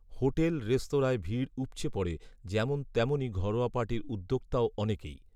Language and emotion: Bengali, neutral